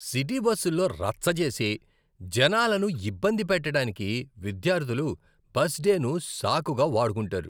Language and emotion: Telugu, disgusted